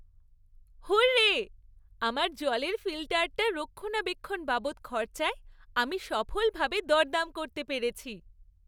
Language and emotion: Bengali, happy